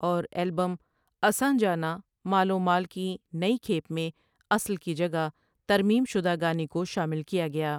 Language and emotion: Urdu, neutral